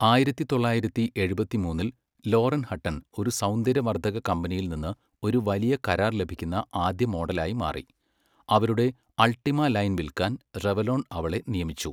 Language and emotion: Malayalam, neutral